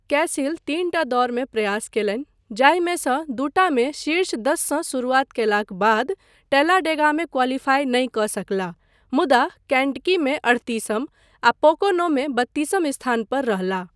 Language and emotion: Maithili, neutral